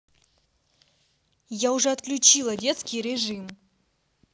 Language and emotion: Russian, angry